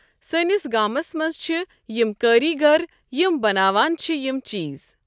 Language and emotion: Kashmiri, neutral